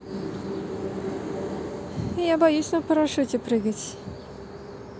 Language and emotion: Russian, neutral